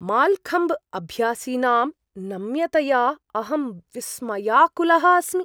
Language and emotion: Sanskrit, surprised